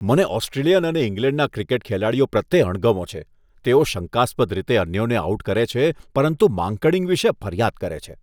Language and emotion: Gujarati, disgusted